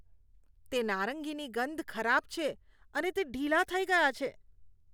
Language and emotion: Gujarati, disgusted